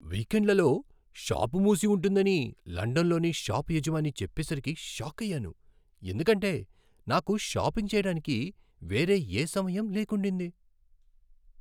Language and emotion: Telugu, surprised